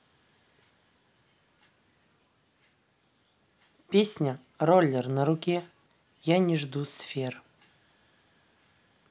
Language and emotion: Russian, neutral